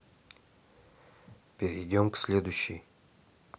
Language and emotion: Russian, neutral